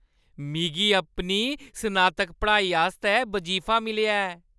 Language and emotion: Dogri, happy